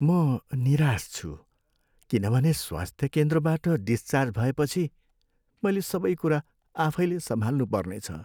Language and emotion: Nepali, sad